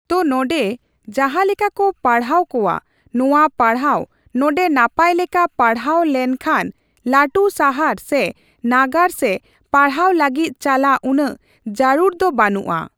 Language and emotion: Santali, neutral